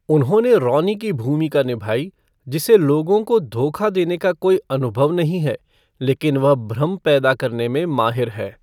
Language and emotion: Hindi, neutral